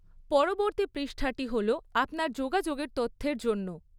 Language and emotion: Bengali, neutral